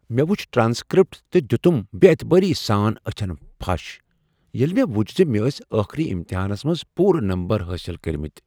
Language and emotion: Kashmiri, surprised